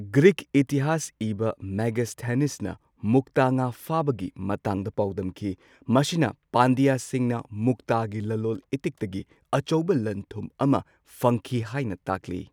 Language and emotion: Manipuri, neutral